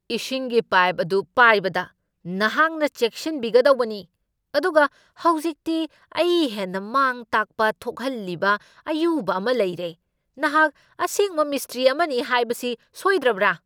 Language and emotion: Manipuri, angry